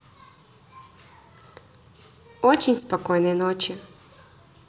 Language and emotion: Russian, positive